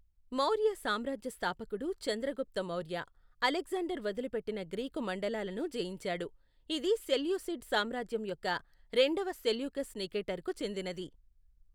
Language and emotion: Telugu, neutral